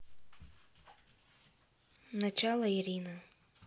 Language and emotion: Russian, sad